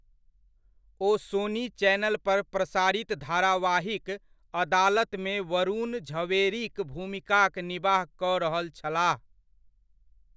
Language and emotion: Maithili, neutral